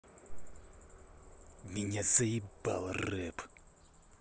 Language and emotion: Russian, angry